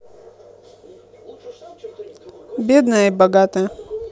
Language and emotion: Russian, neutral